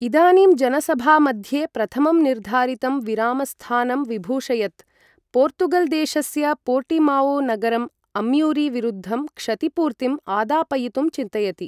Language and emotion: Sanskrit, neutral